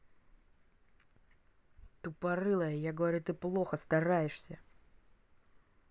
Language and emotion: Russian, angry